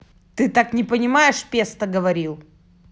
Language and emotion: Russian, angry